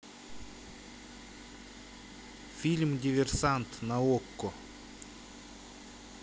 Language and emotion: Russian, neutral